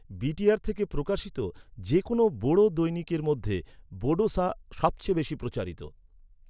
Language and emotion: Bengali, neutral